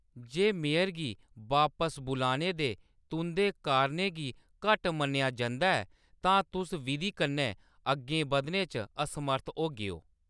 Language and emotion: Dogri, neutral